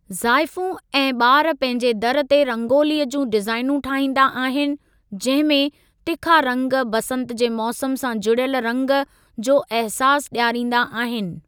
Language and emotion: Sindhi, neutral